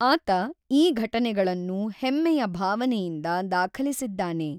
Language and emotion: Kannada, neutral